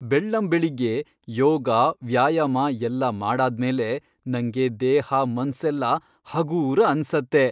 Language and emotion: Kannada, happy